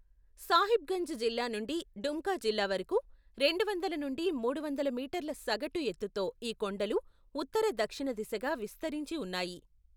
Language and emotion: Telugu, neutral